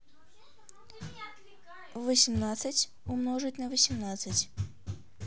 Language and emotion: Russian, neutral